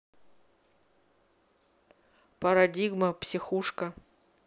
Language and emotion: Russian, neutral